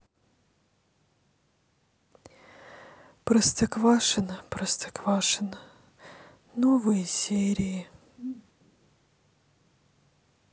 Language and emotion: Russian, sad